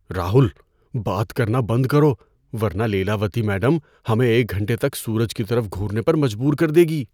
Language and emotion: Urdu, fearful